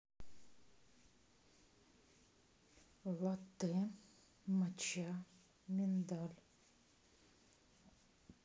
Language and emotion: Russian, neutral